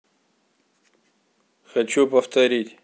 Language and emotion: Russian, neutral